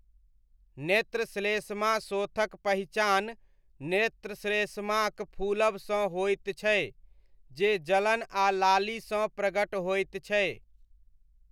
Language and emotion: Maithili, neutral